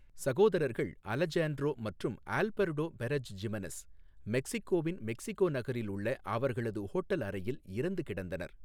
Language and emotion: Tamil, neutral